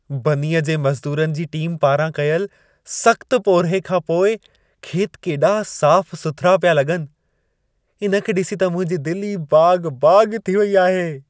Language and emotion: Sindhi, happy